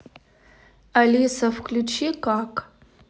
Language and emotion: Russian, neutral